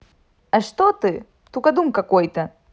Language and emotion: Russian, positive